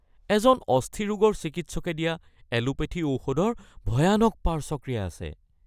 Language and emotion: Assamese, fearful